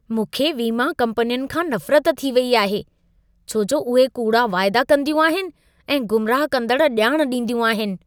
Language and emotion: Sindhi, disgusted